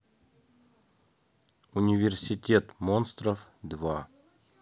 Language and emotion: Russian, neutral